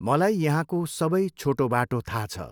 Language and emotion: Nepali, neutral